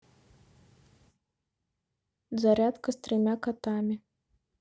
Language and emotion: Russian, neutral